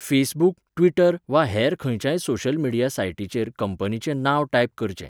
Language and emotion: Goan Konkani, neutral